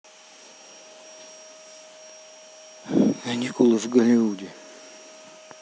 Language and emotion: Russian, neutral